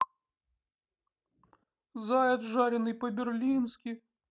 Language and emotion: Russian, sad